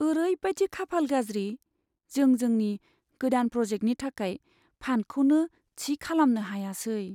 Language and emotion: Bodo, sad